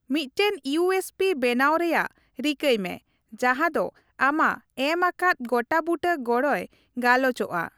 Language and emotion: Santali, neutral